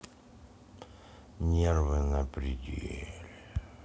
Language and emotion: Russian, neutral